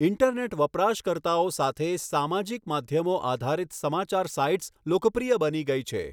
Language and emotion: Gujarati, neutral